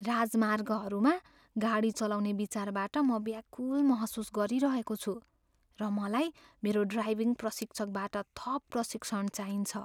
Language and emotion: Nepali, fearful